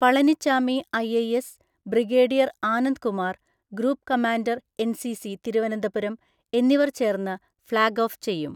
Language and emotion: Malayalam, neutral